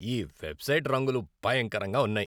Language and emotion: Telugu, disgusted